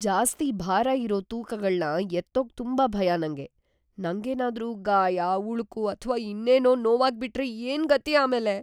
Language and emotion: Kannada, fearful